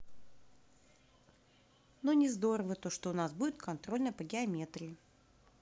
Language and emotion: Russian, neutral